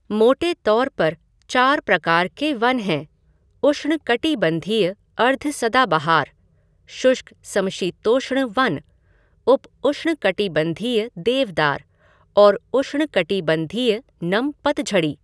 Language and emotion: Hindi, neutral